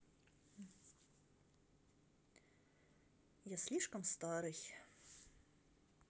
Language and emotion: Russian, sad